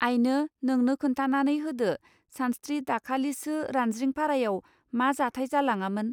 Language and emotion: Bodo, neutral